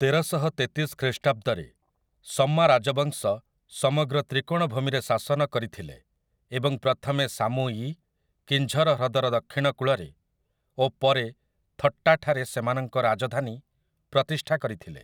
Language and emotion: Odia, neutral